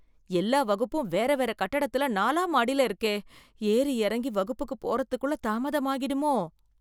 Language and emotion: Tamil, fearful